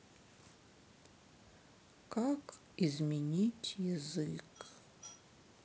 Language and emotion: Russian, sad